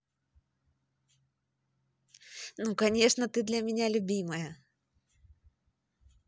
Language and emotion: Russian, positive